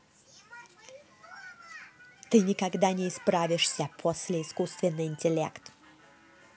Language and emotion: Russian, angry